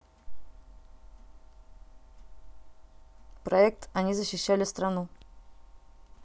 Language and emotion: Russian, neutral